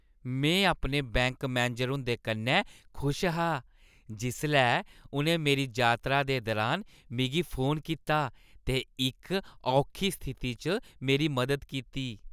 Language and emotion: Dogri, happy